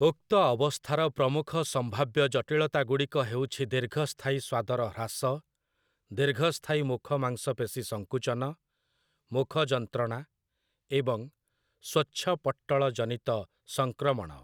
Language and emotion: Odia, neutral